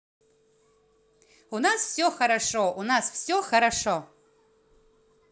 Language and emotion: Russian, positive